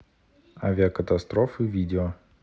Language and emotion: Russian, neutral